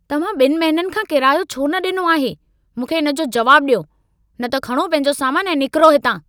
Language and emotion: Sindhi, angry